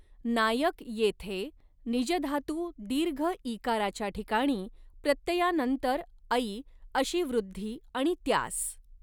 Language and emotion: Marathi, neutral